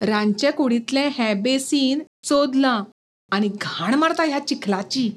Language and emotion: Goan Konkani, disgusted